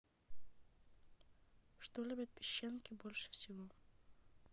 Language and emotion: Russian, neutral